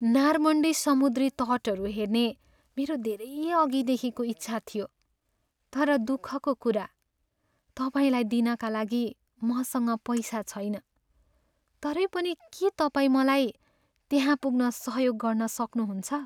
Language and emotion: Nepali, sad